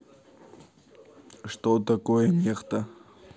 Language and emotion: Russian, neutral